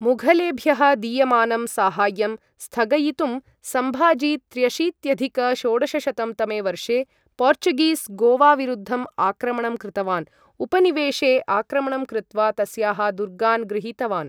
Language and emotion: Sanskrit, neutral